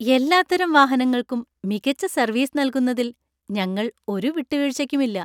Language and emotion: Malayalam, happy